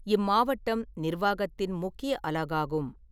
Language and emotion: Tamil, neutral